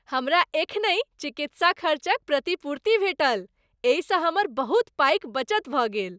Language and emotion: Maithili, happy